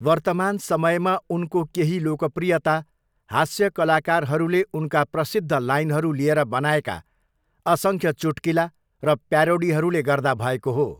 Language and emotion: Nepali, neutral